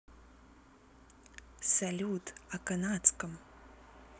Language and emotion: Russian, neutral